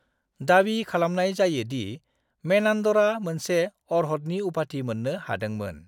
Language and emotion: Bodo, neutral